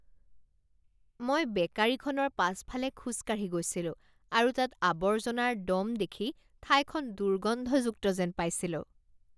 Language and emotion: Assamese, disgusted